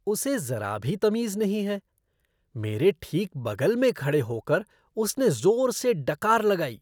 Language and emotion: Hindi, disgusted